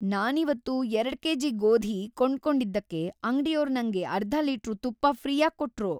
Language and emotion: Kannada, happy